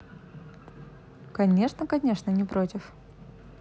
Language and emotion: Russian, positive